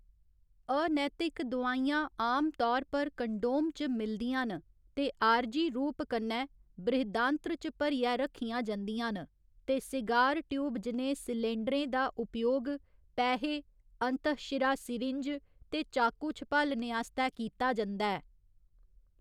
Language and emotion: Dogri, neutral